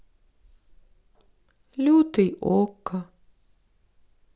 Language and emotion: Russian, sad